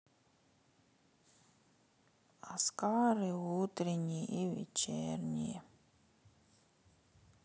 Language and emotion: Russian, sad